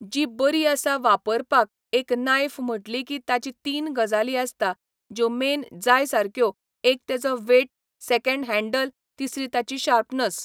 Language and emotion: Goan Konkani, neutral